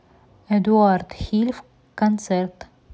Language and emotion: Russian, neutral